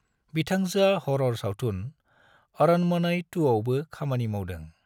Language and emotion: Bodo, neutral